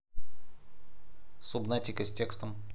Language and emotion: Russian, neutral